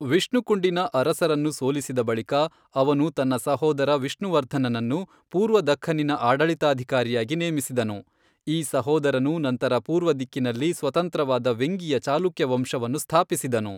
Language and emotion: Kannada, neutral